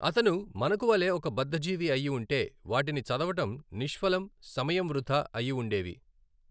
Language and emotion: Telugu, neutral